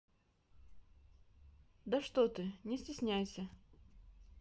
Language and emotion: Russian, neutral